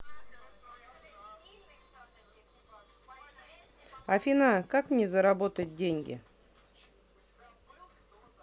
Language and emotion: Russian, neutral